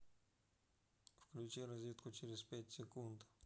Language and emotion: Russian, neutral